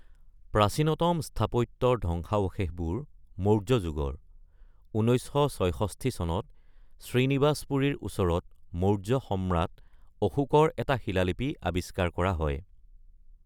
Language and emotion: Assamese, neutral